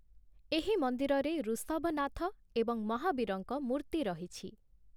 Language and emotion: Odia, neutral